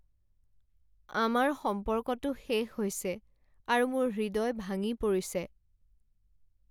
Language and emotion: Assamese, sad